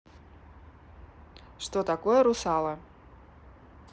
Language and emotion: Russian, neutral